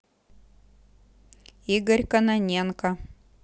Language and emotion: Russian, neutral